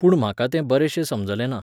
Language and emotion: Goan Konkani, neutral